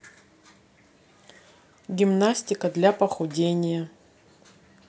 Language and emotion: Russian, neutral